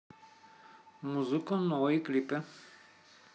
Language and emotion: Russian, neutral